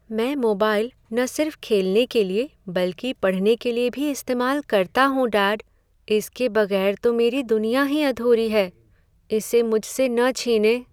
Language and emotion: Hindi, sad